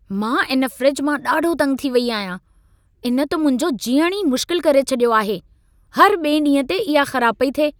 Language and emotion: Sindhi, angry